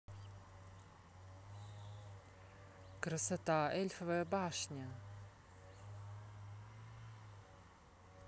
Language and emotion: Russian, neutral